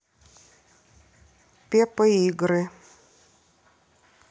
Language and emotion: Russian, neutral